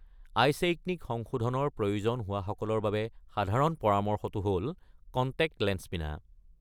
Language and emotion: Assamese, neutral